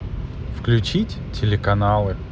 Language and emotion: Russian, positive